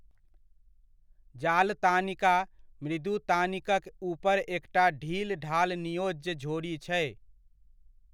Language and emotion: Maithili, neutral